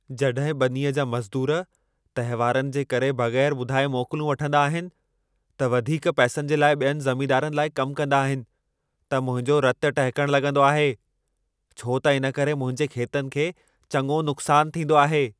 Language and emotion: Sindhi, angry